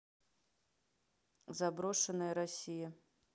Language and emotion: Russian, neutral